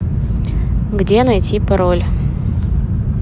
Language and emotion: Russian, neutral